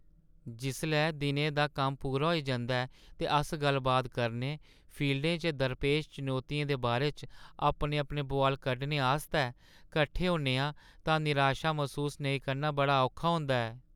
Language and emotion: Dogri, sad